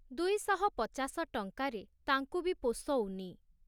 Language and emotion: Odia, neutral